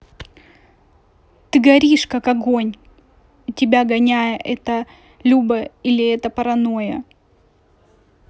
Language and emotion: Russian, neutral